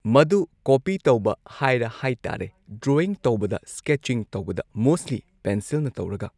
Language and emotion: Manipuri, neutral